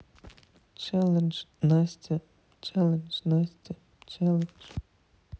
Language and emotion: Russian, sad